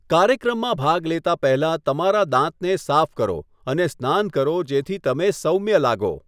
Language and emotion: Gujarati, neutral